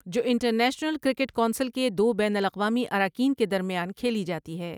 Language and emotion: Urdu, neutral